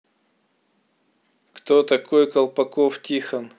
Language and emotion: Russian, neutral